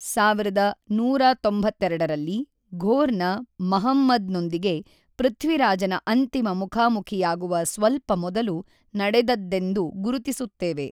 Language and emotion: Kannada, neutral